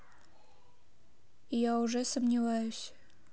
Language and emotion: Russian, neutral